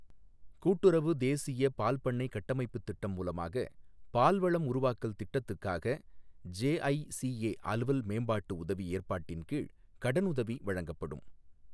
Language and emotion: Tamil, neutral